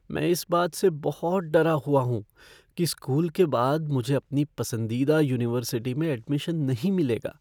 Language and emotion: Hindi, fearful